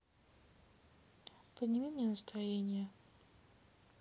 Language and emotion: Russian, sad